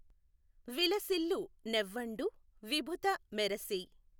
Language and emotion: Telugu, neutral